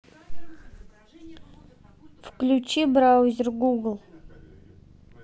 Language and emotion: Russian, neutral